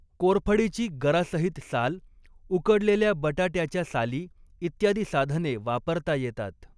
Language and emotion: Marathi, neutral